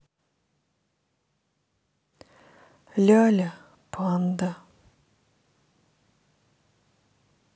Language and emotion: Russian, sad